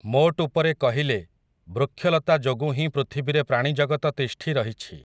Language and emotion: Odia, neutral